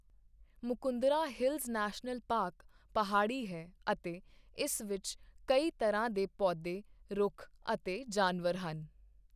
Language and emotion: Punjabi, neutral